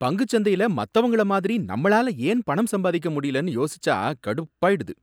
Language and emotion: Tamil, angry